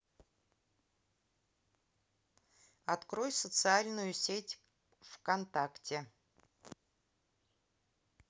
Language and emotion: Russian, neutral